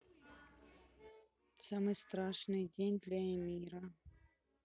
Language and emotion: Russian, sad